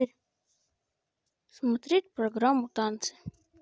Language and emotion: Russian, neutral